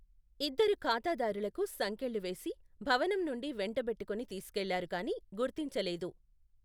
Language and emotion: Telugu, neutral